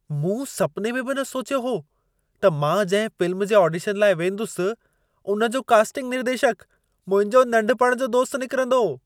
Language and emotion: Sindhi, surprised